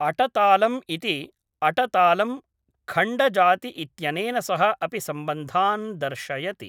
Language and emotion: Sanskrit, neutral